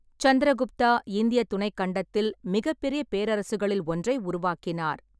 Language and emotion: Tamil, neutral